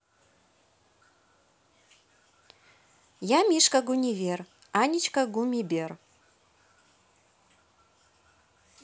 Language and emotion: Russian, positive